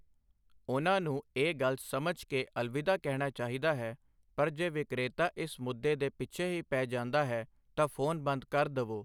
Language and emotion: Punjabi, neutral